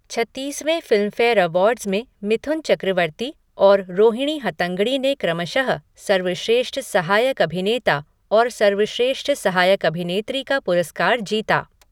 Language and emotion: Hindi, neutral